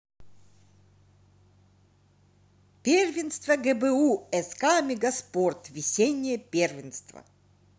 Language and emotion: Russian, positive